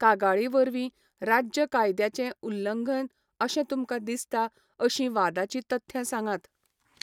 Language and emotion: Goan Konkani, neutral